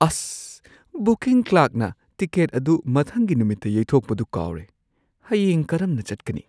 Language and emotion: Manipuri, surprised